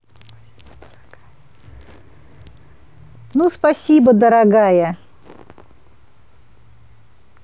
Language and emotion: Russian, positive